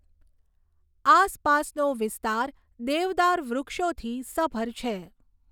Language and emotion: Gujarati, neutral